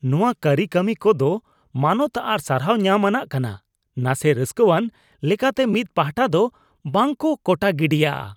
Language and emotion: Santali, disgusted